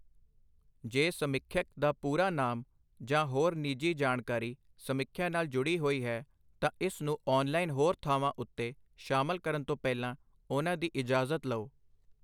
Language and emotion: Punjabi, neutral